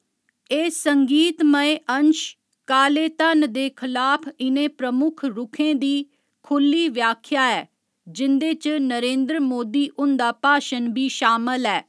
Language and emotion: Dogri, neutral